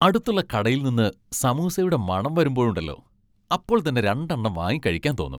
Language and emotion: Malayalam, happy